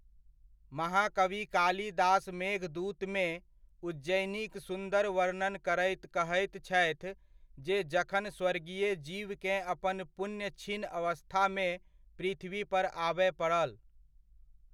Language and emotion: Maithili, neutral